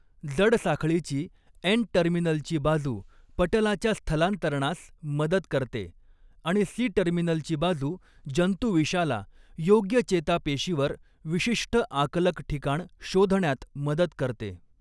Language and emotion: Marathi, neutral